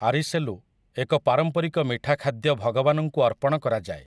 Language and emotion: Odia, neutral